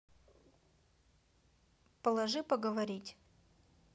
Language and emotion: Russian, neutral